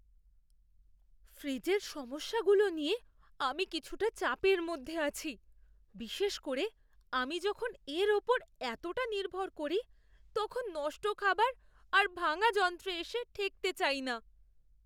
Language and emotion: Bengali, fearful